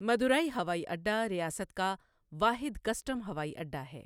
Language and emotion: Urdu, neutral